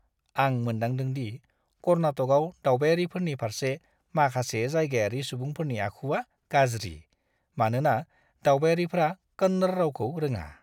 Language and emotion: Bodo, disgusted